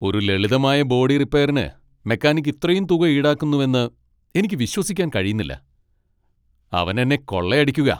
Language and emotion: Malayalam, angry